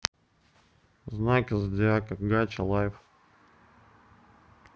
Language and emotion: Russian, neutral